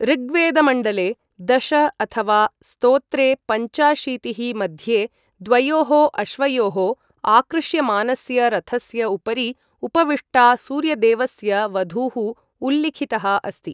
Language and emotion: Sanskrit, neutral